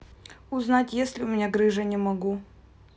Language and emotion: Russian, neutral